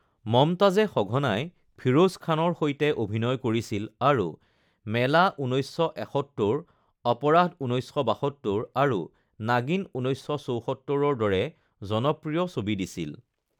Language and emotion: Assamese, neutral